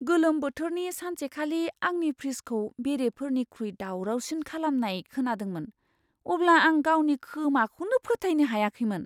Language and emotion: Bodo, surprised